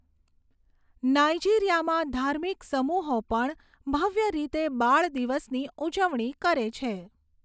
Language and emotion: Gujarati, neutral